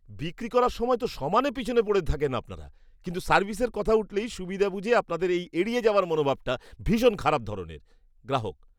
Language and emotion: Bengali, disgusted